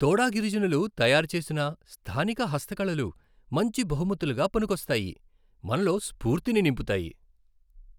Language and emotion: Telugu, happy